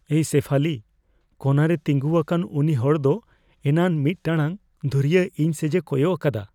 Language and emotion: Santali, fearful